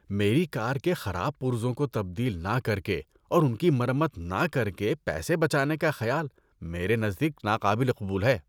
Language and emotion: Urdu, disgusted